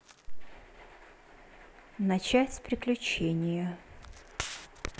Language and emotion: Russian, neutral